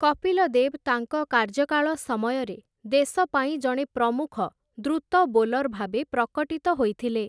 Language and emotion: Odia, neutral